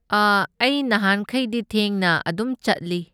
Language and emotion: Manipuri, neutral